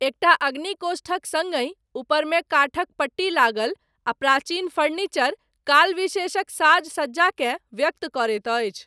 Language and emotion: Maithili, neutral